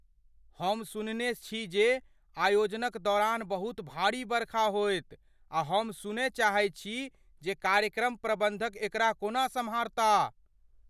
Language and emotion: Maithili, fearful